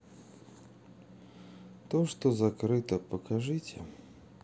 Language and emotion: Russian, sad